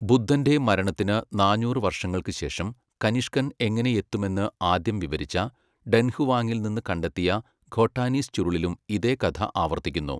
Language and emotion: Malayalam, neutral